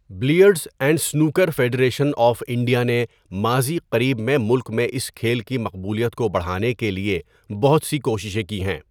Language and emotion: Urdu, neutral